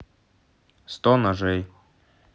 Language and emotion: Russian, neutral